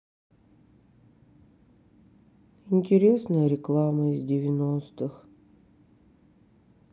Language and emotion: Russian, sad